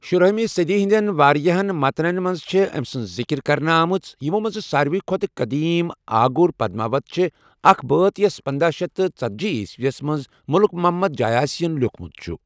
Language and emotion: Kashmiri, neutral